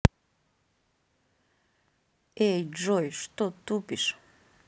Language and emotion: Russian, neutral